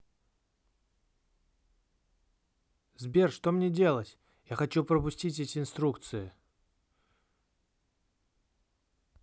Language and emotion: Russian, neutral